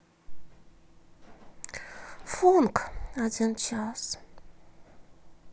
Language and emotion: Russian, sad